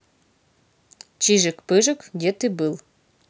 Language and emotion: Russian, neutral